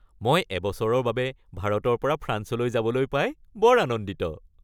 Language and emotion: Assamese, happy